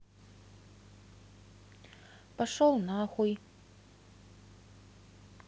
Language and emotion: Russian, neutral